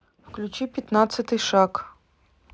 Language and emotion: Russian, neutral